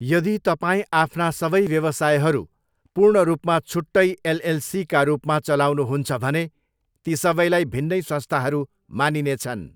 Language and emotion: Nepali, neutral